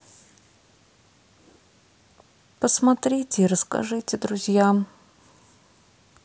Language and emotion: Russian, sad